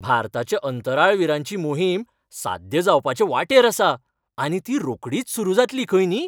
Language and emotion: Goan Konkani, happy